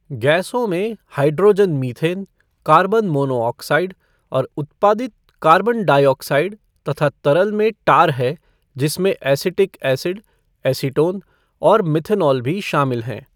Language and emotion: Hindi, neutral